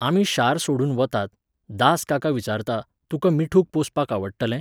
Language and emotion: Goan Konkani, neutral